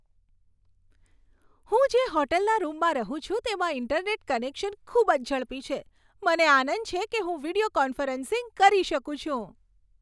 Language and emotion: Gujarati, happy